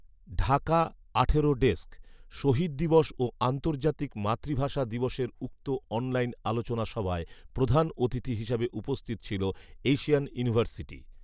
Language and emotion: Bengali, neutral